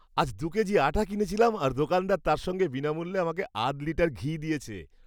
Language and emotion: Bengali, happy